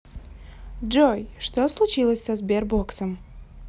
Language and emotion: Russian, neutral